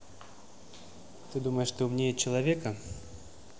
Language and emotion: Russian, neutral